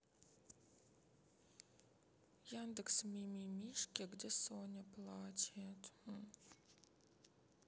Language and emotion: Russian, sad